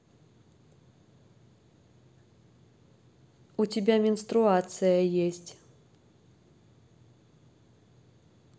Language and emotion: Russian, neutral